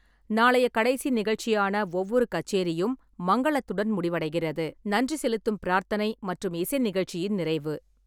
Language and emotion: Tamil, neutral